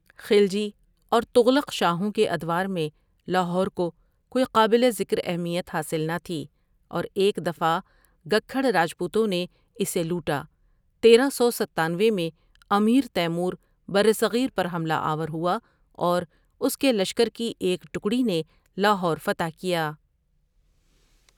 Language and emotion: Urdu, neutral